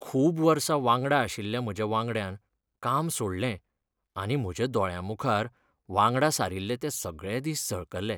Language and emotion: Goan Konkani, sad